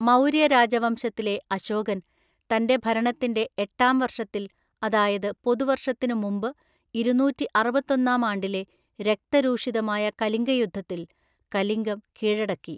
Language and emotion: Malayalam, neutral